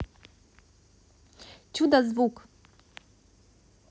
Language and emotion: Russian, positive